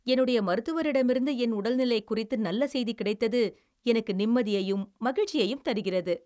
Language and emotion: Tamil, happy